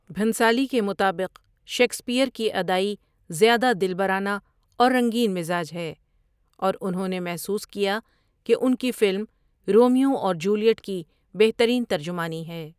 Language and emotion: Urdu, neutral